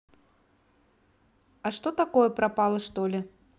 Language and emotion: Russian, neutral